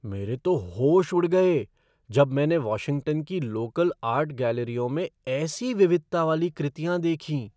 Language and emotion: Hindi, surprised